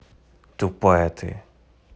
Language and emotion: Russian, angry